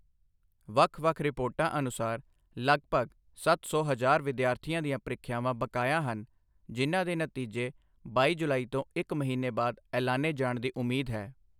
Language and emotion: Punjabi, neutral